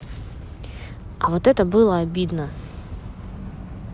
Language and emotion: Russian, angry